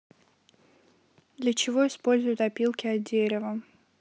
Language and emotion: Russian, neutral